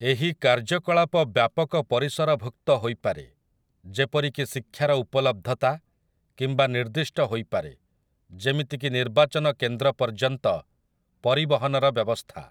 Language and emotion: Odia, neutral